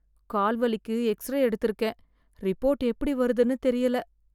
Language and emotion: Tamil, fearful